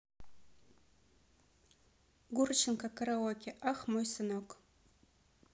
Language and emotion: Russian, neutral